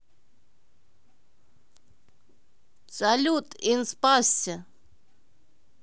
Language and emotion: Russian, positive